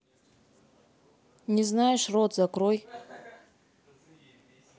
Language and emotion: Russian, angry